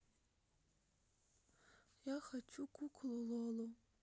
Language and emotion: Russian, sad